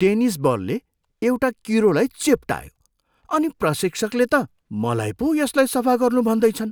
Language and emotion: Nepali, disgusted